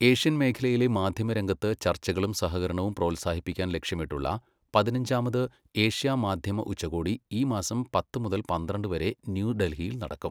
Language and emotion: Malayalam, neutral